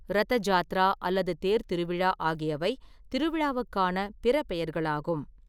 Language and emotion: Tamil, neutral